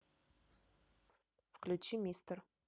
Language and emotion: Russian, neutral